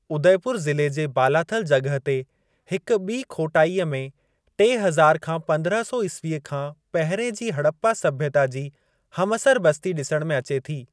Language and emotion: Sindhi, neutral